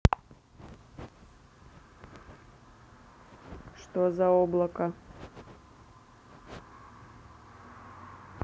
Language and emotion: Russian, neutral